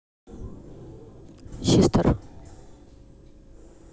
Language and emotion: Russian, neutral